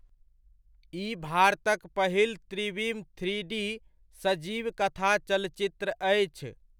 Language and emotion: Maithili, neutral